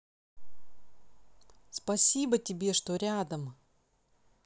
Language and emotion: Russian, positive